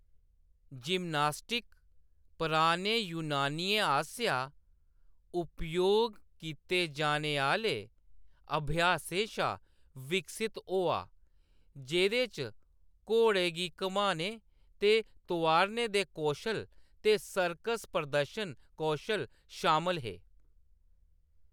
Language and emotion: Dogri, neutral